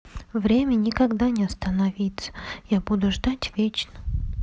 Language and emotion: Russian, sad